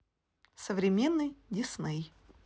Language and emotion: Russian, neutral